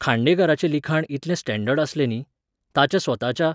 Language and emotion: Goan Konkani, neutral